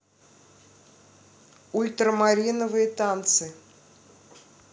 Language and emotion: Russian, neutral